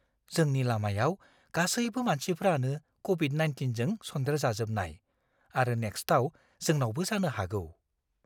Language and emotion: Bodo, fearful